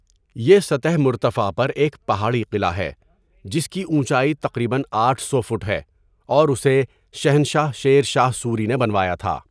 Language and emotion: Urdu, neutral